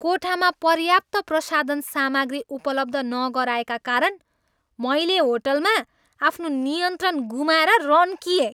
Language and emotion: Nepali, angry